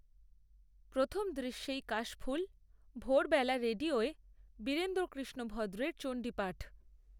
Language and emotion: Bengali, neutral